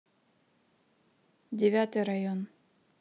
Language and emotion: Russian, neutral